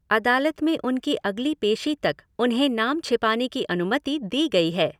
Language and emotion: Hindi, neutral